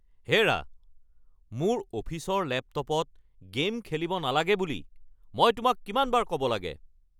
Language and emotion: Assamese, angry